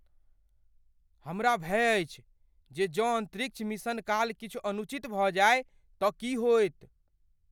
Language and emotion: Maithili, fearful